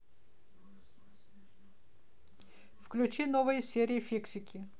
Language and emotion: Russian, neutral